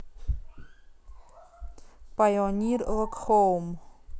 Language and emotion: Russian, neutral